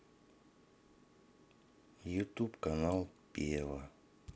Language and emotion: Russian, neutral